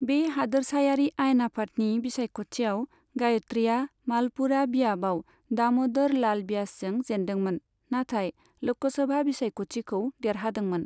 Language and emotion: Bodo, neutral